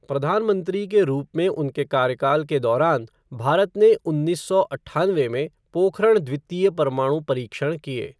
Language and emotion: Hindi, neutral